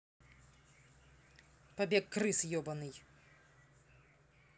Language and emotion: Russian, angry